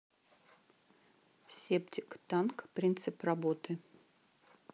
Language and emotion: Russian, neutral